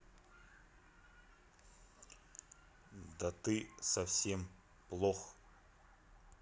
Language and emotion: Russian, neutral